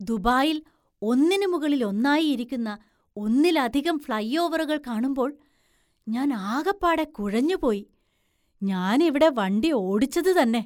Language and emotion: Malayalam, surprised